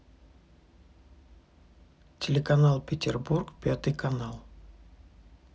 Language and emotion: Russian, neutral